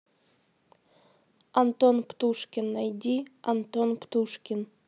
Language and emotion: Russian, neutral